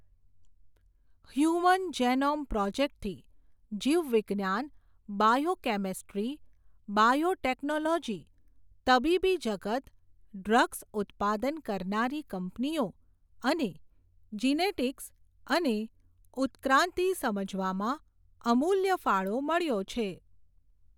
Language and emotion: Gujarati, neutral